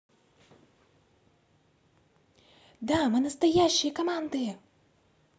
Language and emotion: Russian, positive